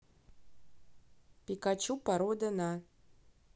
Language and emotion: Russian, neutral